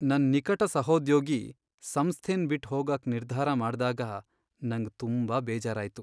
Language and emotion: Kannada, sad